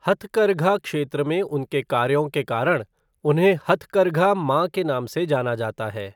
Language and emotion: Hindi, neutral